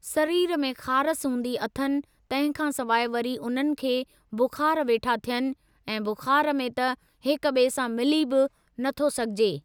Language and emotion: Sindhi, neutral